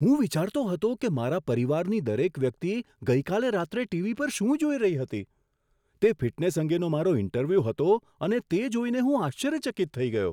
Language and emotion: Gujarati, surprised